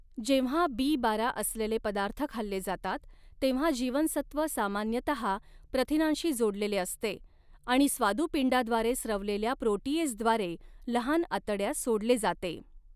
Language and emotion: Marathi, neutral